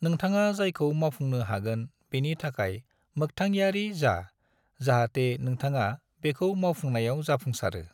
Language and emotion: Bodo, neutral